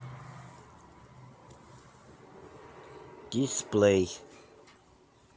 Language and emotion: Russian, neutral